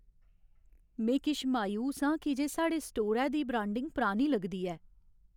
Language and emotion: Dogri, sad